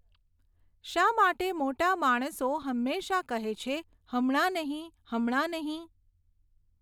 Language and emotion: Gujarati, neutral